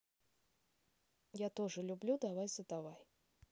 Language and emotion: Russian, neutral